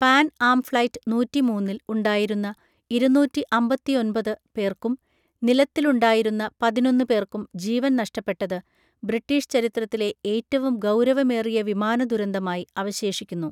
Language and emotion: Malayalam, neutral